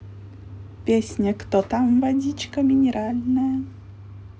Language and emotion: Russian, positive